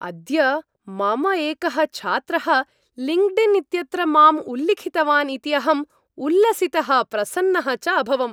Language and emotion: Sanskrit, happy